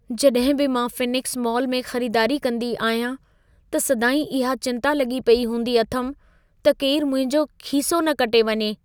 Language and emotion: Sindhi, fearful